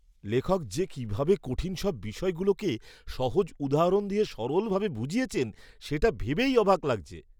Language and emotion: Bengali, surprised